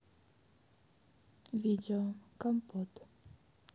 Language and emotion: Russian, sad